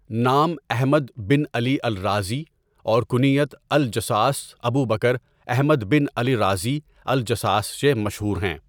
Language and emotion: Urdu, neutral